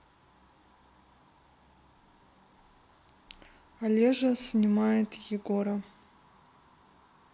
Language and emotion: Russian, neutral